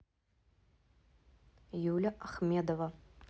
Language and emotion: Russian, neutral